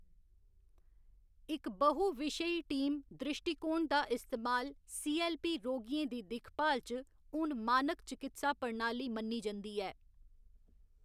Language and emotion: Dogri, neutral